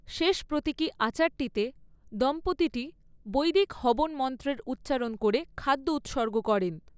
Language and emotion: Bengali, neutral